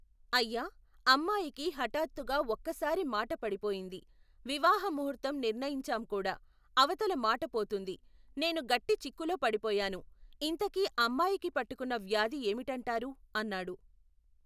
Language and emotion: Telugu, neutral